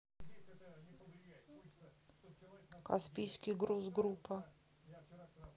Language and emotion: Russian, neutral